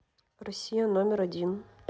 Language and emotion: Russian, neutral